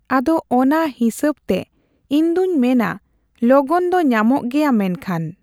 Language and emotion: Santali, neutral